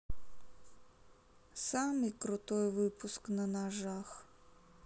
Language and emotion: Russian, sad